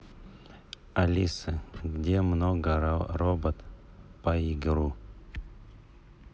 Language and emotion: Russian, neutral